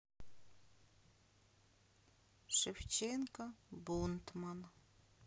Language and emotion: Russian, sad